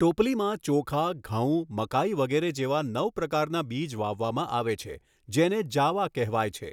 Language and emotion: Gujarati, neutral